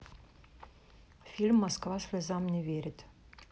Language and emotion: Russian, neutral